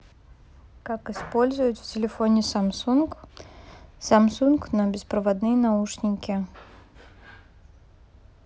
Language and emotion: Russian, neutral